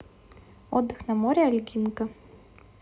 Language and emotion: Russian, neutral